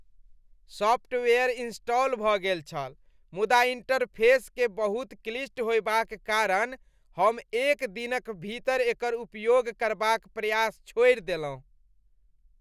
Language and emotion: Maithili, disgusted